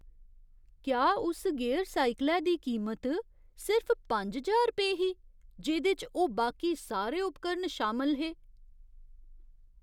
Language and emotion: Dogri, surprised